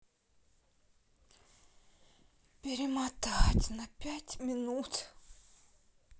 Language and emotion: Russian, sad